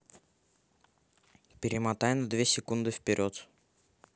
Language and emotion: Russian, neutral